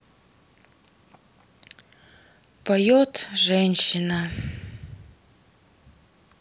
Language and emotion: Russian, sad